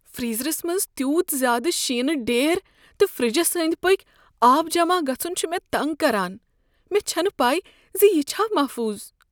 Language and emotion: Kashmiri, fearful